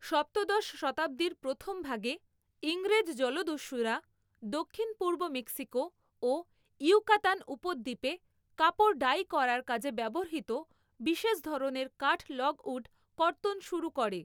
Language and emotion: Bengali, neutral